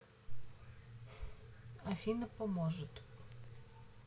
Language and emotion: Russian, neutral